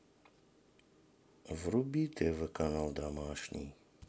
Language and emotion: Russian, sad